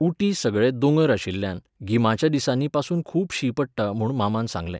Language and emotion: Goan Konkani, neutral